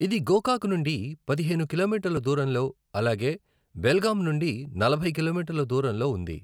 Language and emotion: Telugu, neutral